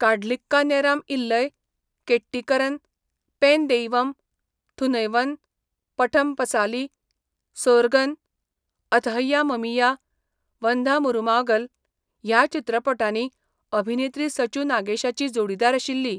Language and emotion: Goan Konkani, neutral